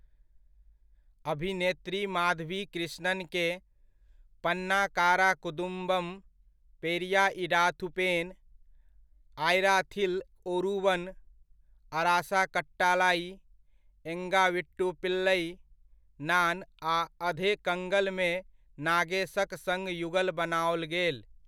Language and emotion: Maithili, neutral